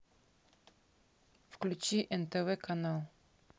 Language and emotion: Russian, neutral